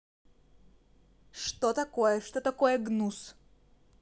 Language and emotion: Russian, angry